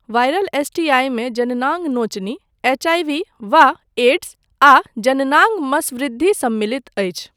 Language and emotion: Maithili, neutral